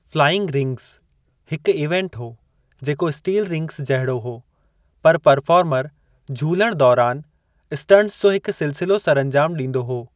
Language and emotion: Sindhi, neutral